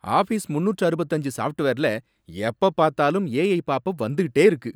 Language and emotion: Tamil, angry